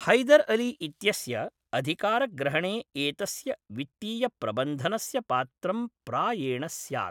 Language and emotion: Sanskrit, neutral